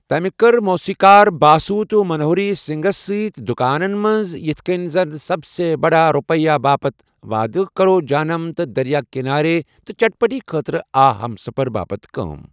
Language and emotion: Kashmiri, neutral